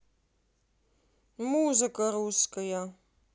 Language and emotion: Russian, neutral